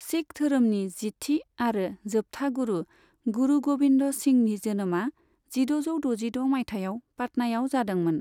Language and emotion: Bodo, neutral